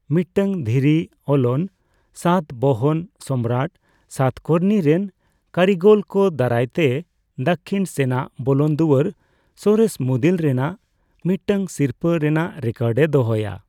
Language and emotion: Santali, neutral